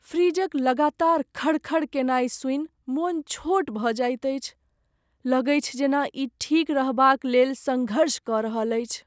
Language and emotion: Maithili, sad